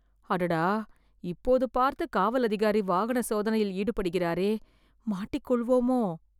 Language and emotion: Tamil, fearful